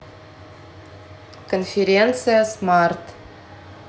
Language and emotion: Russian, neutral